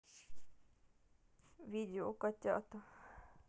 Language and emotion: Russian, sad